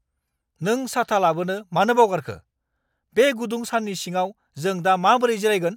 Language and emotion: Bodo, angry